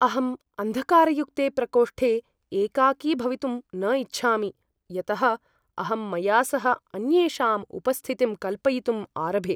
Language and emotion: Sanskrit, fearful